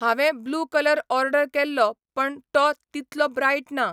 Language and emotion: Goan Konkani, neutral